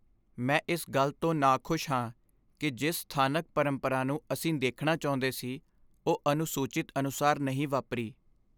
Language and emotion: Punjabi, sad